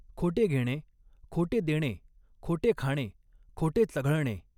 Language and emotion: Marathi, neutral